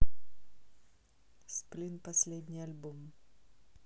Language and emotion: Russian, neutral